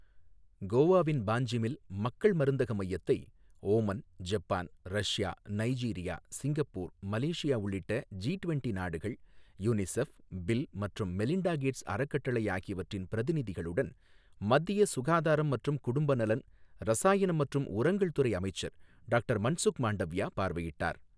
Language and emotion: Tamil, neutral